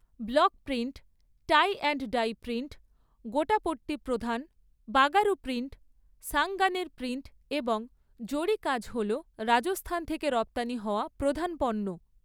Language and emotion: Bengali, neutral